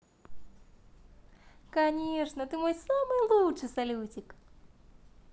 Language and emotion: Russian, positive